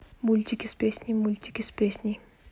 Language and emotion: Russian, neutral